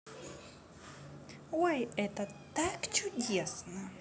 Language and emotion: Russian, positive